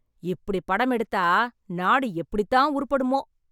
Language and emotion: Tamil, angry